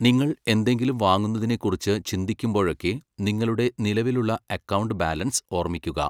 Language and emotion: Malayalam, neutral